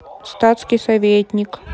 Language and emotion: Russian, neutral